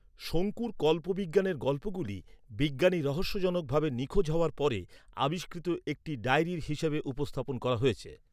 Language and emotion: Bengali, neutral